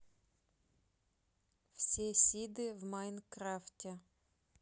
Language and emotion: Russian, neutral